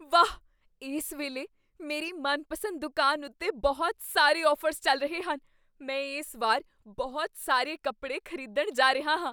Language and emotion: Punjabi, surprised